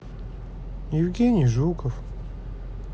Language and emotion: Russian, sad